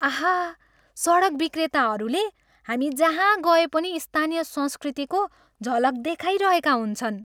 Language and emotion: Nepali, happy